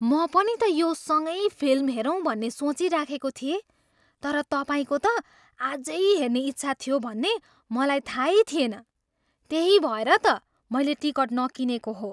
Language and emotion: Nepali, surprised